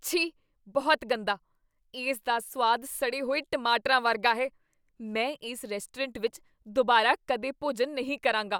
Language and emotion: Punjabi, disgusted